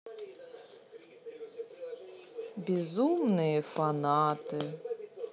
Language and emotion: Russian, sad